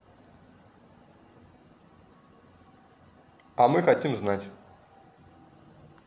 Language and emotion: Russian, neutral